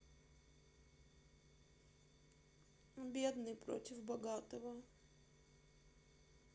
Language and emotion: Russian, sad